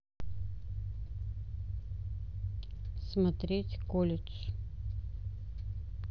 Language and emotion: Russian, neutral